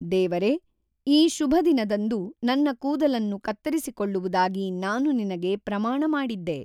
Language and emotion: Kannada, neutral